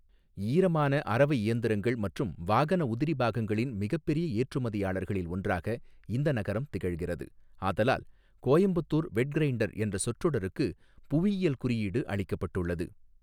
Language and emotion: Tamil, neutral